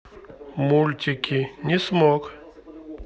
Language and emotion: Russian, neutral